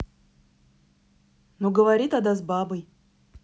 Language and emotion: Russian, angry